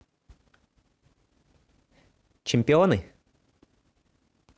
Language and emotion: Russian, neutral